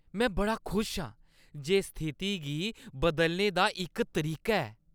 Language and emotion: Dogri, happy